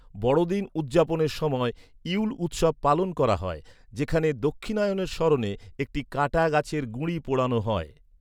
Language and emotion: Bengali, neutral